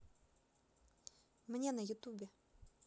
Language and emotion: Russian, neutral